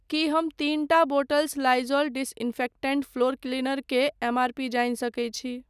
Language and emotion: Maithili, neutral